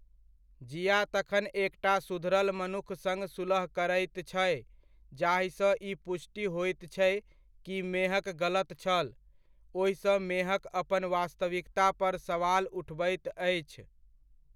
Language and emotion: Maithili, neutral